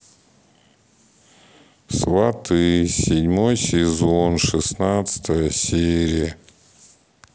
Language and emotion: Russian, sad